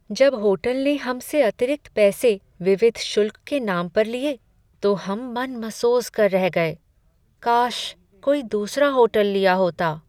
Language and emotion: Hindi, sad